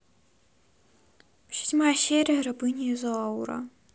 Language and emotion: Russian, sad